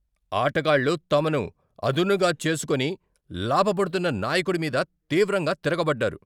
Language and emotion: Telugu, angry